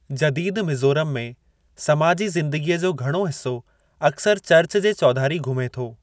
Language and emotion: Sindhi, neutral